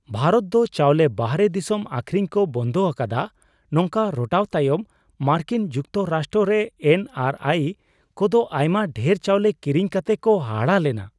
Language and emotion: Santali, surprised